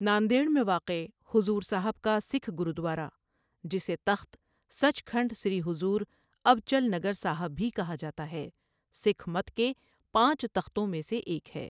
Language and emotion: Urdu, neutral